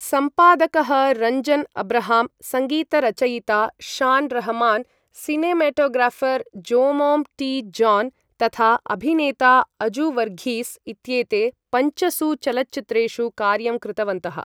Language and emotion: Sanskrit, neutral